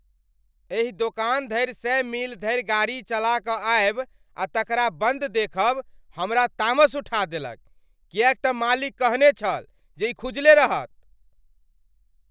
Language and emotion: Maithili, angry